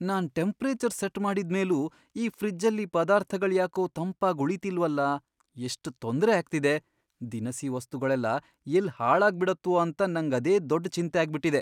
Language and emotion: Kannada, fearful